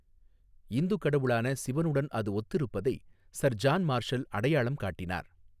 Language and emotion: Tamil, neutral